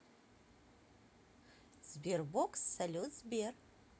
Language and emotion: Russian, positive